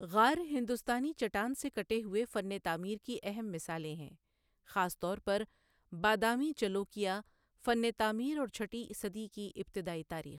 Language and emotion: Urdu, neutral